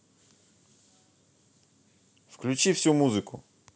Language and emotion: Russian, neutral